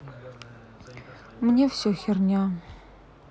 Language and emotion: Russian, sad